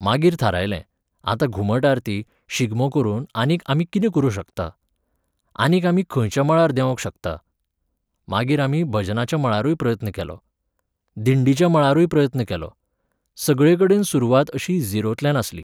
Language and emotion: Goan Konkani, neutral